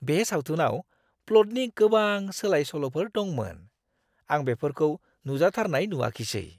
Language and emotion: Bodo, surprised